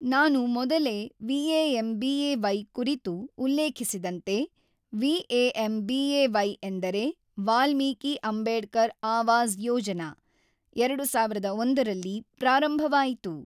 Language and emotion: Kannada, neutral